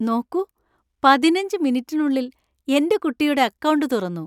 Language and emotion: Malayalam, happy